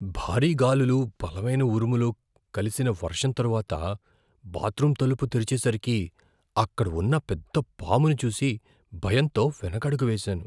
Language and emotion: Telugu, fearful